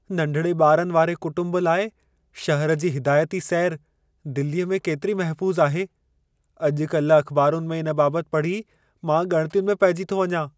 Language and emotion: Sindhi, fearful